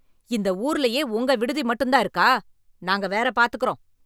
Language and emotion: Tamil, angry